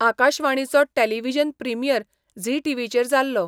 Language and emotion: Goan Konkani, neutral